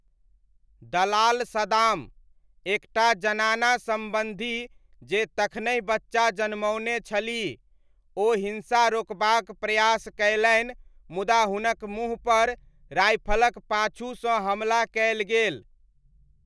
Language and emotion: Maithili, neutral